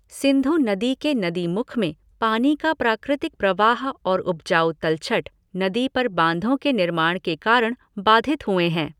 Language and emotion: Hindi, neutral